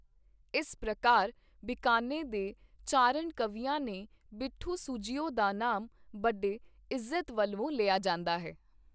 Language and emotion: Punjabi, neutral